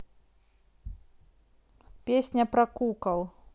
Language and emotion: Russian, neutral